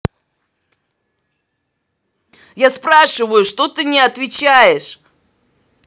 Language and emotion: Russian, angry